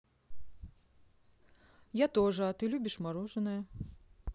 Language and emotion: Russian, neutral